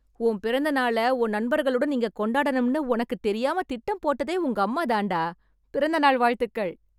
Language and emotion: Tamil, happy